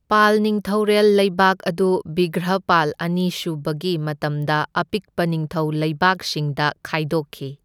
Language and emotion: Manipuri, neutral